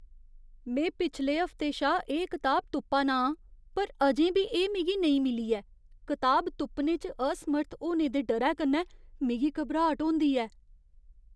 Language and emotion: Dogri, fearful